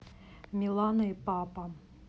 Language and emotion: Russian, neutral